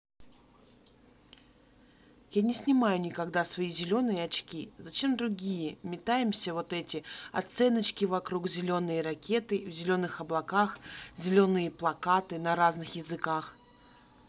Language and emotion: Russian, neutral